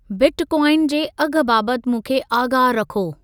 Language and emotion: Sindhi, neutral